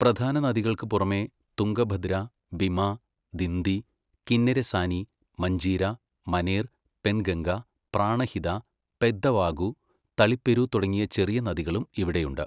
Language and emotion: Malayalam, neutral